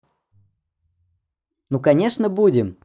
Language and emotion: Russian, positive